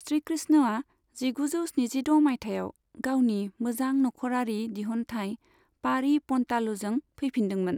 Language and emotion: Bodo, neutral